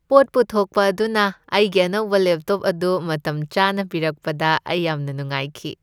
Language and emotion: Manipuri, happy